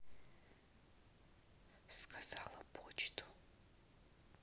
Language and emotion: Russian, neutral